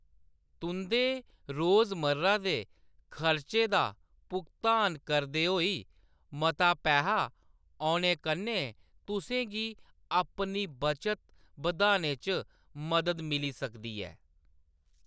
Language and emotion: Dogri, neutral